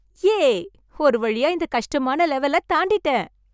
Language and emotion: Tamil, happy